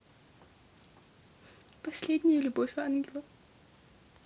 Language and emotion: Russian, sad